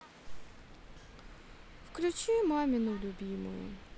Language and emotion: Russian, sad